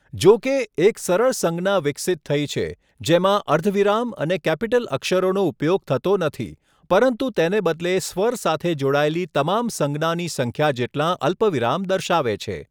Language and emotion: Gujarati, neutral